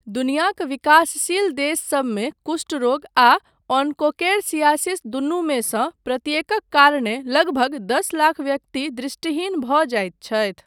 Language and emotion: Maithili, neutral